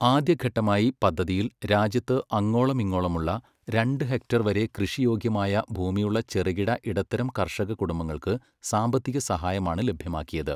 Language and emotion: Malayalam, neutral